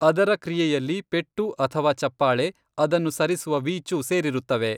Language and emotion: Kannada, neutral